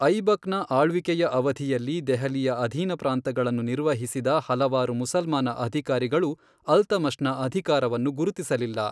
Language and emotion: Kannada, neutral